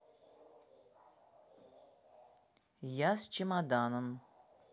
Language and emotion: Russian, neutral